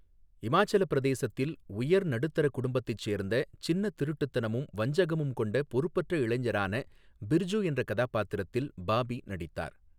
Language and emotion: Tamil, neutral